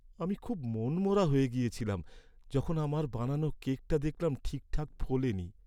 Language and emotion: Bengali, sad